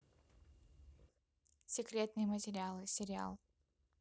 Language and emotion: Russian, neutral